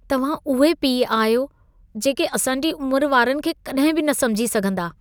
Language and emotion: Sindhi, disgusted